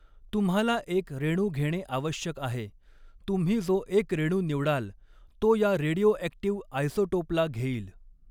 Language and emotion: Marathi, neutral